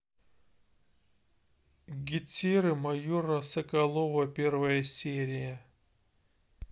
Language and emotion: Russian, neutral